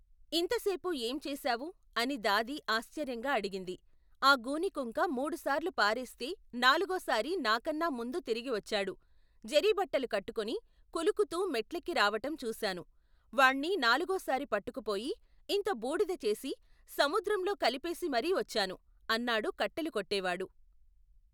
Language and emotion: Telugu, neutral